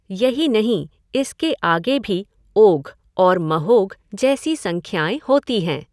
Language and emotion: Hindi, neutral